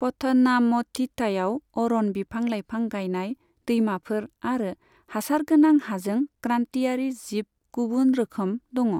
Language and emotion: Bodo, neutral